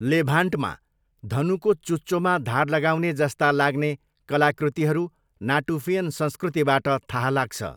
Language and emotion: Nepali, neutral